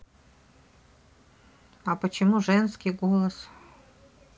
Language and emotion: Russian, neutral